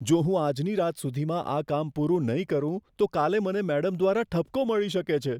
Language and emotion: Gujarati, fearful